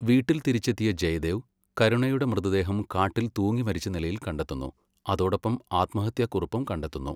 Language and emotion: Malayalam, neutral